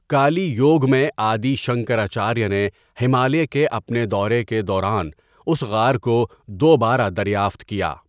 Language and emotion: Urdu, neutral